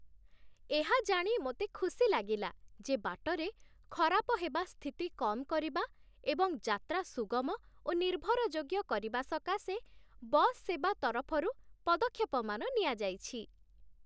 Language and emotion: Odia, happy